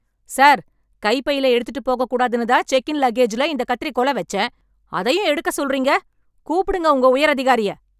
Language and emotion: Tamil, angry